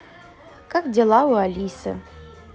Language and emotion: Russian, positive